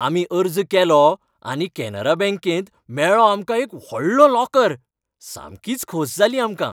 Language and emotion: Goan Konkani, happy